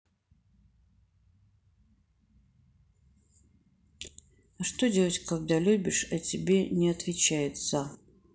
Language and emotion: Russian, neutral